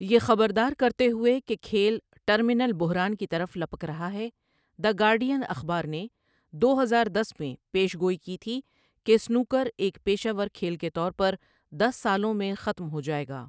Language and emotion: Urdu, neutral